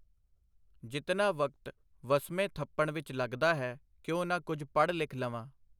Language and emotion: Punjabi, neutral